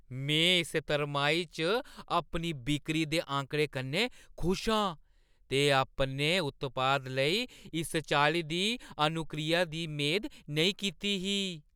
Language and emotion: Dogri, surprised